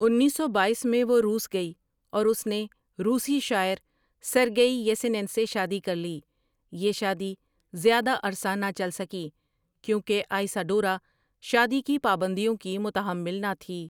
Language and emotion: Urdu, neutral